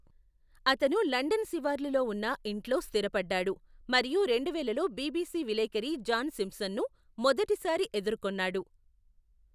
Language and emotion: Telugu, neutral